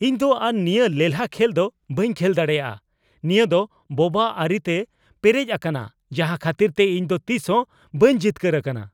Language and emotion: Santali, angry